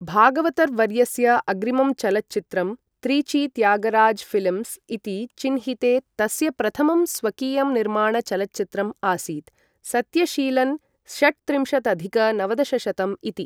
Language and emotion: Sanskrit, neutral